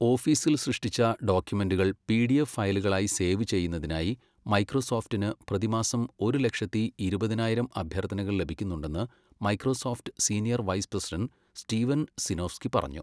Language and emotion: Malayalam, neutral